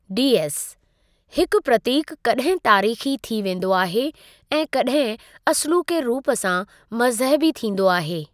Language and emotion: Sindhi, neutral